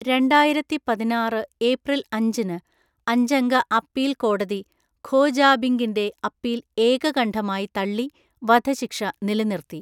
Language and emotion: Malayalam, neutral